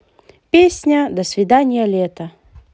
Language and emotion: Russian, positive